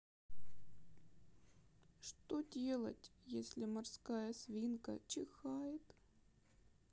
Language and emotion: Russian, sad